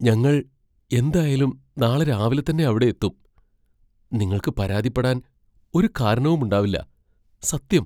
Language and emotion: Malayalam, fearful